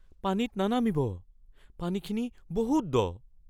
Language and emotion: Assamese, fearful